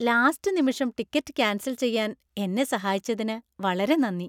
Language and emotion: Malayalam, happy